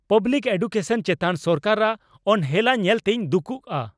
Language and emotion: Santali, angry